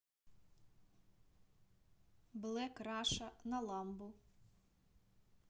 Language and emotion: Russian, neutral